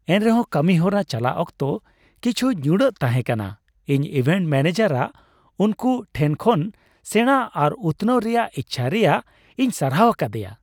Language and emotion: Santali, happy